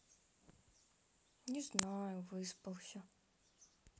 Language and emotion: Russian, sad